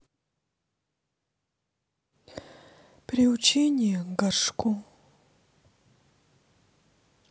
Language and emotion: Russian, sad